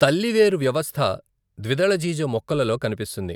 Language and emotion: Telugu, neutral